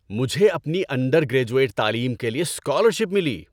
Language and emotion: Urdu, happy